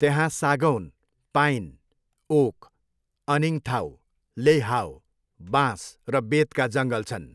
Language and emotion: Nepali, neutral